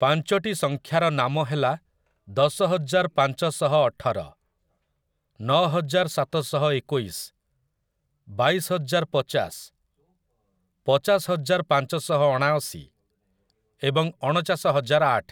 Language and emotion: Odia, neutral